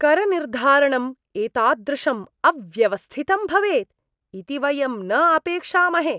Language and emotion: Sanskrit, disgusted